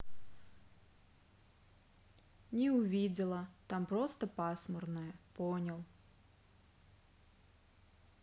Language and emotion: Russian, neutral